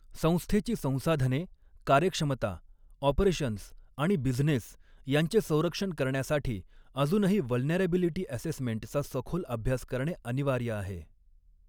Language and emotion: Marathi, neutral